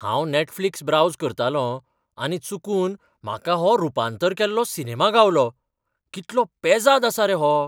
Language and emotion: Goan Konkani, surprised